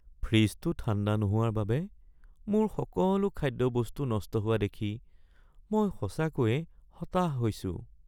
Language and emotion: Assamese, sad